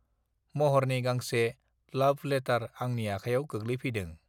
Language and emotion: Bodo, neutral